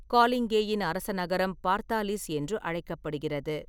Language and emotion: Tamil, neutral